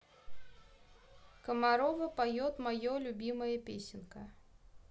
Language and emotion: Russian, neutral